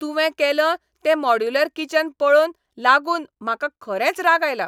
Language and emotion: Goan Konkani, angry